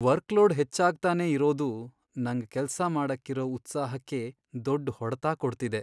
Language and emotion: Kannada, sad